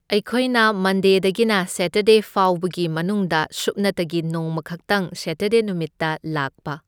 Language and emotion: Manipuri, neutral